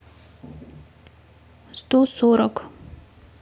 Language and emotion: Russian, neutral